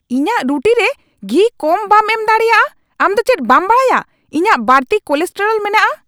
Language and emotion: Santali, angry